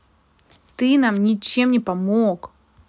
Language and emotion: Russian, angry